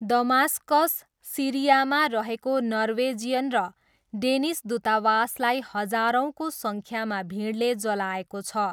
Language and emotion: Nepali, neutral